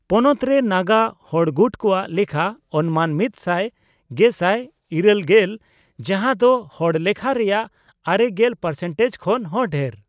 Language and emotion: Santali, neutral